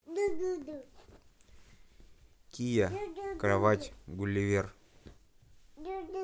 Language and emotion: Russian, neutral